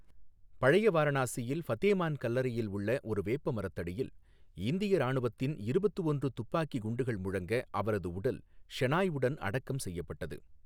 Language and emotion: Tamil, neutral